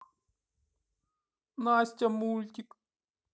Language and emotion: Russian, sad